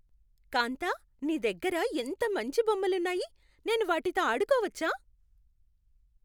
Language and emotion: Telugu, happy